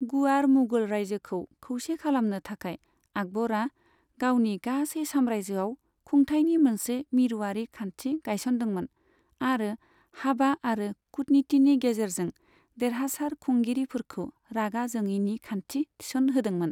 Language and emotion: Bodo, neutral